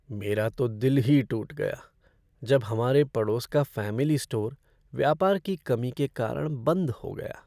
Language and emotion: Hindi, sad